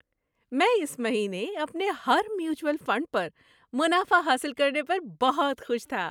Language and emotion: Urdu, happy